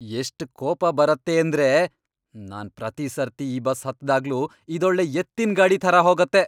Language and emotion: Kannada, angry